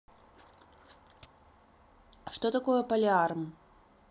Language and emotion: Russian, neutral